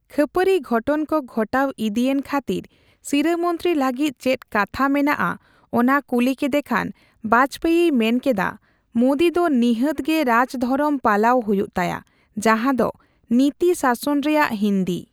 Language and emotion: Santali, neutral